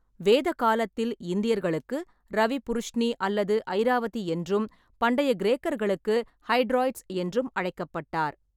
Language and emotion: Tamil, neutral